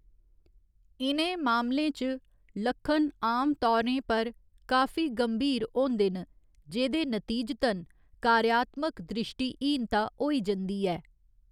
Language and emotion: Dogri, neutral